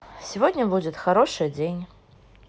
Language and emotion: Russian, positive